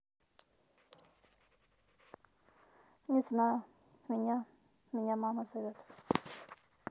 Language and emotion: Russian, neutral